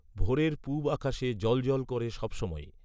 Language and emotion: Bengali, neutral